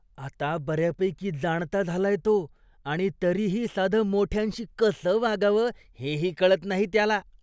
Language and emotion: Marathi, disgusted